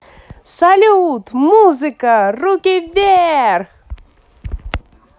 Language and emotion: Russian, positive